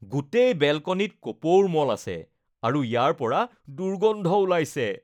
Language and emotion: Assamese, disgusted